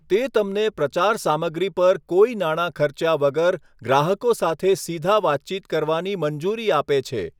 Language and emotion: Gujarati, neutral